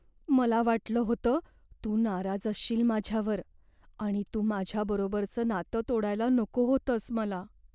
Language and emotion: Marathi, fearful